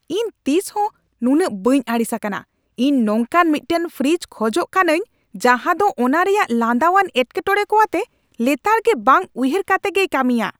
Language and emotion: Santali, angry